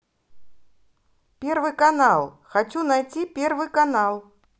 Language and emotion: Russian, positive